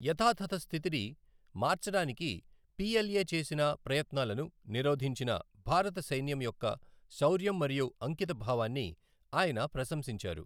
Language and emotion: Telugu, neutral